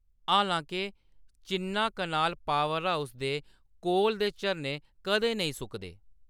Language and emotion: Dogri, neutral